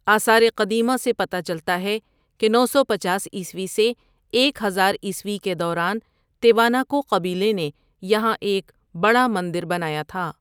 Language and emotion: Urdu, neutral